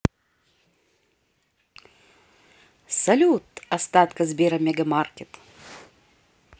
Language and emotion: Russian, positive